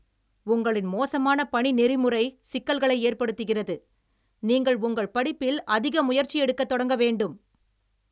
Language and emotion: Tamil, angry